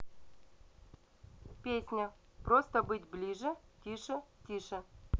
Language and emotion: Russian, neutral